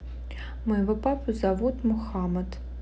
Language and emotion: Russian, neutral